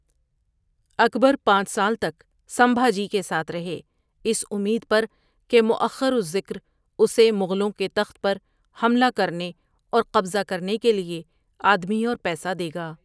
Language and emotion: Urdu, neutral